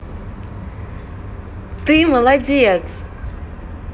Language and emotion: Russian, positive